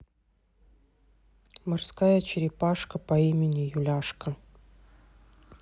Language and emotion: Russian, neutral